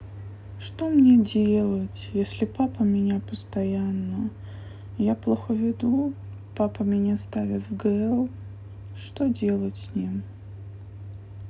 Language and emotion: Russian, sad